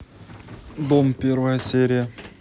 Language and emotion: Russian, neutral